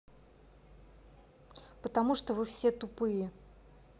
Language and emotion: Russian, angry